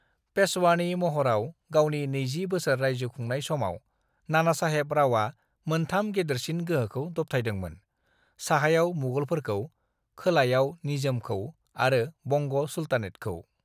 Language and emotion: Bodo, neutral